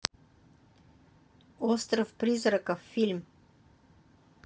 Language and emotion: Russian, neutral